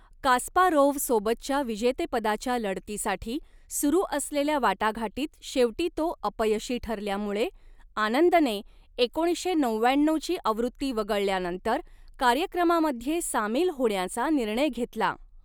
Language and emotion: Marathi, neutral